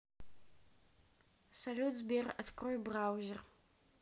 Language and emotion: Russian, neutral